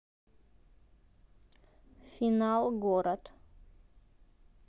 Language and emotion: Russian, neutral